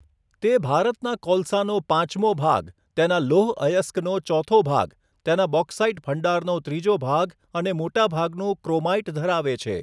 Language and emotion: Gujarati, neutral